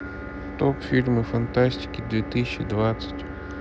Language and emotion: Russian, neutral